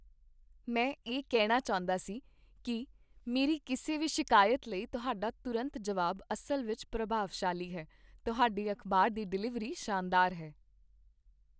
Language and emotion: Punjabi, happy